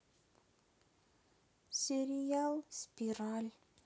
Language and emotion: Russian, sad